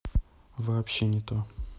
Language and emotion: Russian, neutral